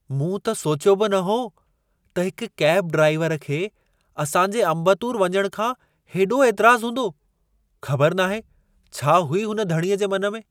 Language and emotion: Sindhi, surprised